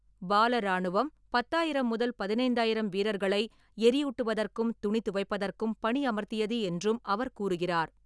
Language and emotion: Tamil, neutral